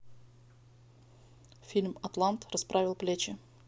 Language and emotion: Russian, neutral